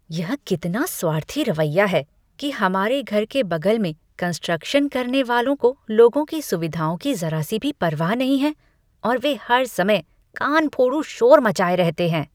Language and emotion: Hindi, disgusted